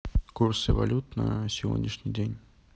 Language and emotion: Russian, neutral